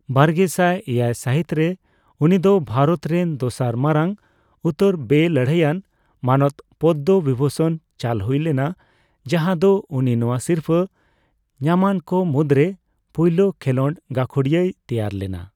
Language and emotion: Santali, neutral